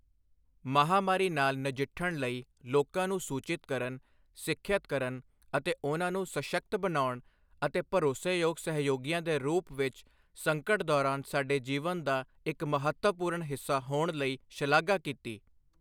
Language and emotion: Punjabi, neutral